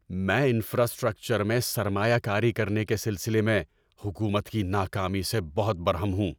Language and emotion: Urdu, angry